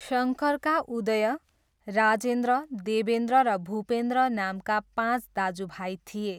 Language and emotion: Nepali, neutral